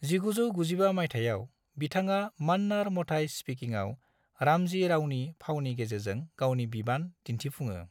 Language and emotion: Bodo, neutral